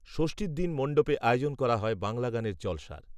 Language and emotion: Bengali, neutral